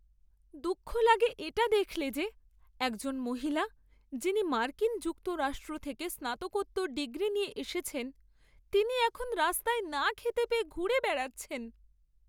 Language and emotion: Bengali, sad